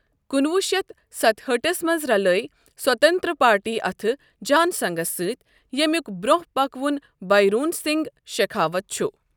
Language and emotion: Kashmiri, neutral